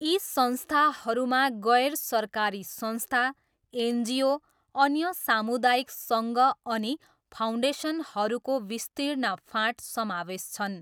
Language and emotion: Nepali, neutral